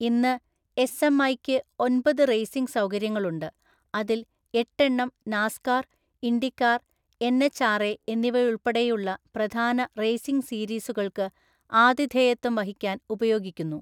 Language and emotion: Malayalam, neutral